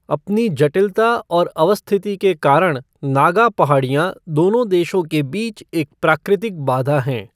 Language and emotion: Hindi, neutral